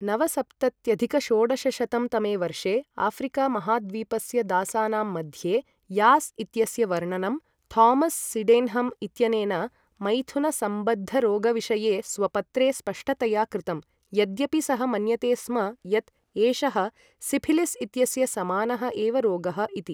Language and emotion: Sanskrit, neutral